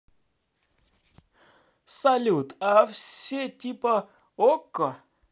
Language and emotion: Russian, positive